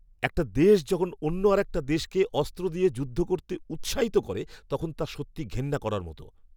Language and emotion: Bengali, angry